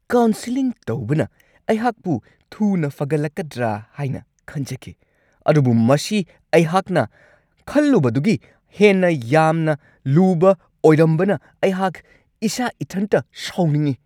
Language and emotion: Manipuri, angry